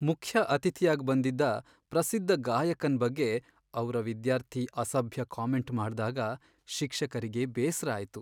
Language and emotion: Kannada, sad